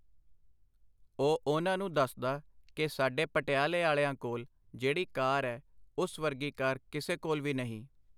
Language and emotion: Punjabi, neutral